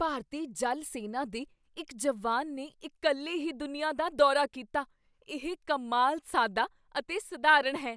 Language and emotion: Punjabi, surprised